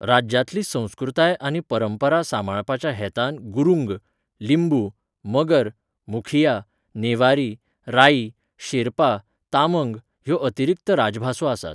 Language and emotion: Goan Konkani, neutral